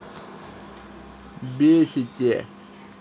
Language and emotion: Russian, angry